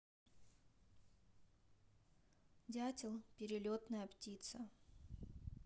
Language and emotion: Russian, neutral